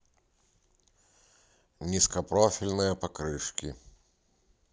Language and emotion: Russian, neutral